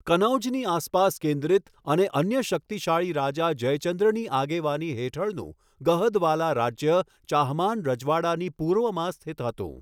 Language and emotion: Gujarati, neutral